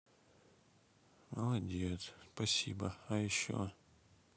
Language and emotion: Russian, sad